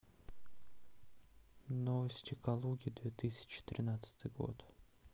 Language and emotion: Russian, neutral